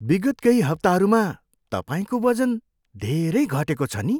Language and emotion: Nepali, surprised